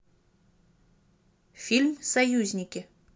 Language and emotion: Russian, neutral